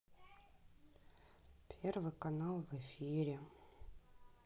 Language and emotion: Russian, sad